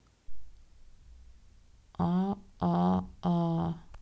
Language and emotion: Russian, neutral